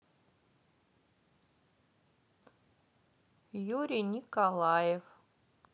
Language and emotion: Russian, neutral